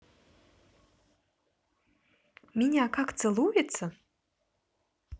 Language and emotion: Russian, neutral